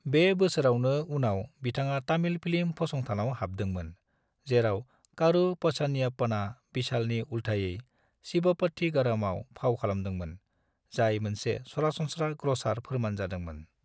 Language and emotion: Bodo, neutral